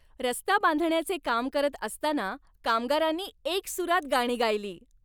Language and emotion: Marathi, happy